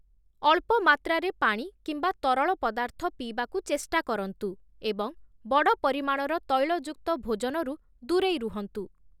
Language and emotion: Odia, neutral